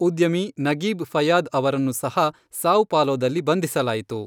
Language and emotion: Kannada, neutral